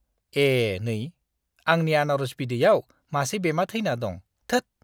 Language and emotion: Bodo, disgusted